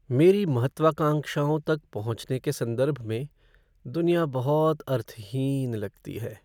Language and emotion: Hindi, sad